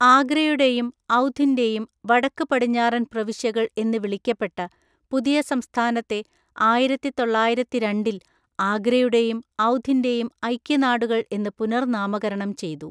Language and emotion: Malayalam, neutral